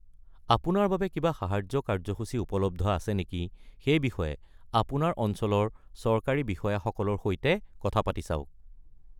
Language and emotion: Assamese, neutral